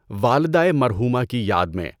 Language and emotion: Urdu, neutral